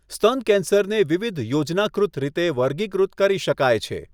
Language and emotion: Gujarati, neutral